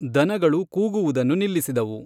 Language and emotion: Kannada, neutral